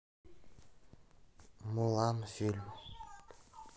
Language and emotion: Russian, sad